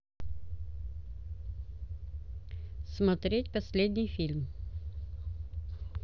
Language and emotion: Russian, neutral